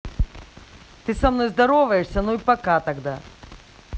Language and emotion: Russian, angry